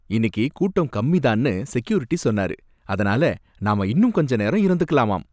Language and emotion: Tamil, happy